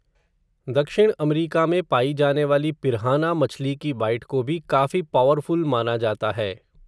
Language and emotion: Hindi, neutral